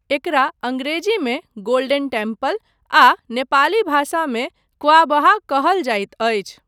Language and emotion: Maithili, neutral